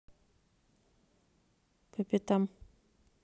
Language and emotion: Russian, neutral